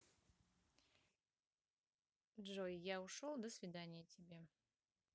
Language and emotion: Russian, neutral